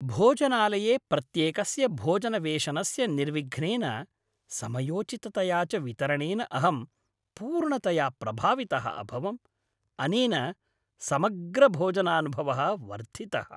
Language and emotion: Sanskrit, happy